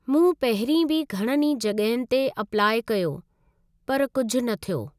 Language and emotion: Sindhi, neutral